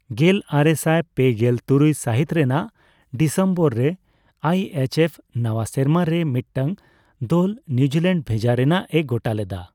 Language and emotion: Santali, neutral